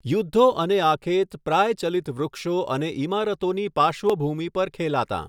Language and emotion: Gujarati, neutral